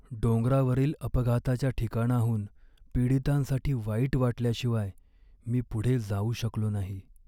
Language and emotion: Marathi, sad